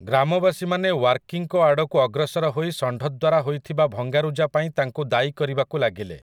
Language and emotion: Odia, neutral